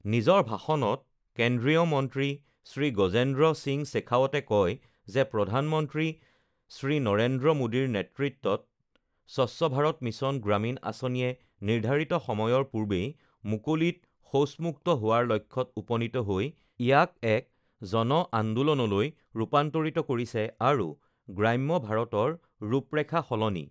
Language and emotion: Assamese, neutral